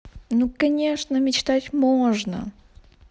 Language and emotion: Russian, positive